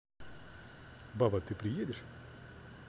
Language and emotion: Russian, neutral